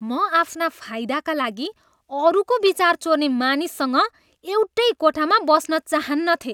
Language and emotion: Nepali, disgusted